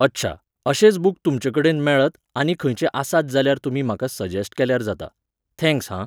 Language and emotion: Goan Konkani, neutral